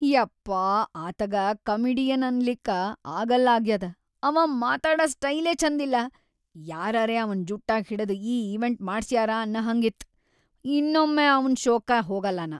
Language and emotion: Kannada, disgusted